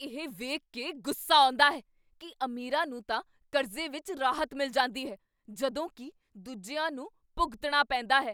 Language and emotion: Punjabi, angry